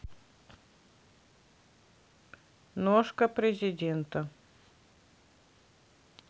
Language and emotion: Russian, neutral